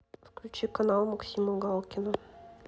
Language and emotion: Russian, neutral